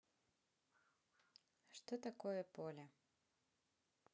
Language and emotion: Russian, neutral